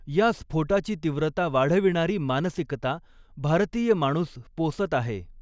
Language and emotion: Marathi, neutral